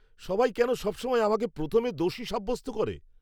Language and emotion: Bengali, angry